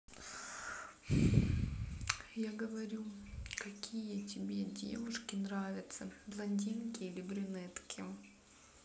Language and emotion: Russian, sad